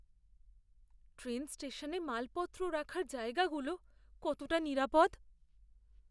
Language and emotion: Bengali, fearful